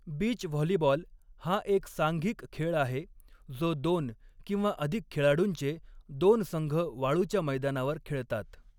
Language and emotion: Marathi, neutral